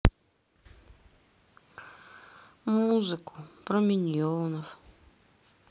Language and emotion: Russian, sad